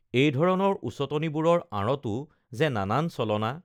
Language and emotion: Assamese, neutral